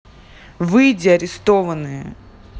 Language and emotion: Russian, angry